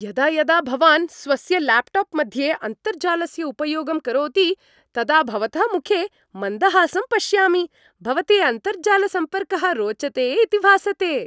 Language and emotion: Sanskrit, happy